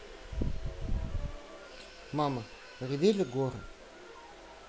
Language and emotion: Russian, neutral